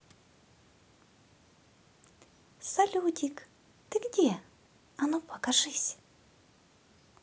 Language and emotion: Russian, positive